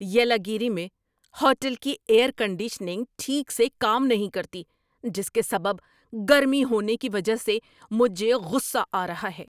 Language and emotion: Urdu, angry